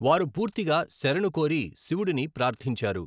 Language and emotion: Telugu, neutral